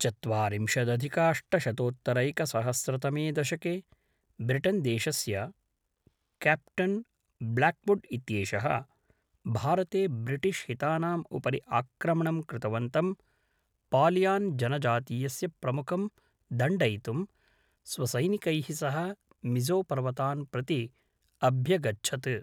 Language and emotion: Sanskrit, neutral